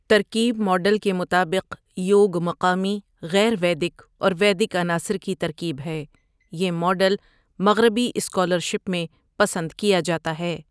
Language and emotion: Urdu, neutral